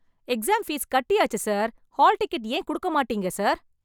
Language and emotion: Tamil, angry